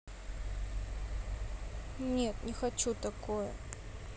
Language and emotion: Russian, sad